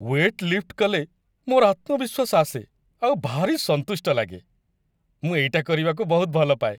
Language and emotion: Odia, happy